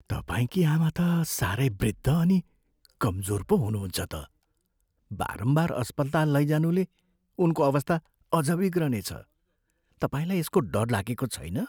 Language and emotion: Nepali, fearful